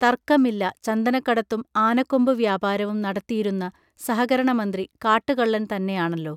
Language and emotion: Malayalam, neutral